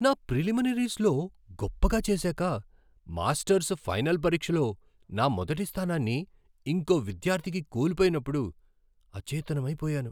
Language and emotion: Telugu, surprised